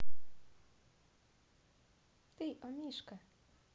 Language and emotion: Russian, positive